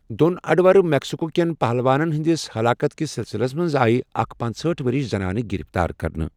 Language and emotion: Kashmiri, neutral